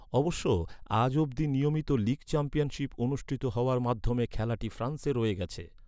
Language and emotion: Bengali, neutral